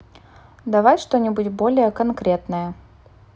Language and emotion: Russian, neutral